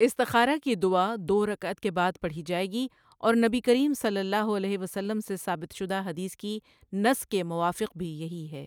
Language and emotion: Urdu, neutral